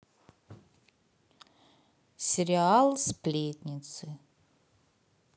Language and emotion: Russian, neutral